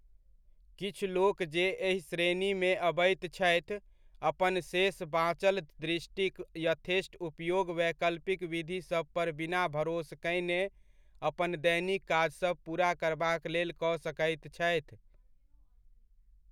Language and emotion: Maithili, neutral